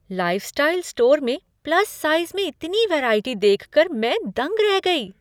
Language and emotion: Hindi, surprised